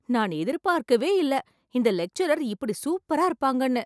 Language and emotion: Tamil, surprised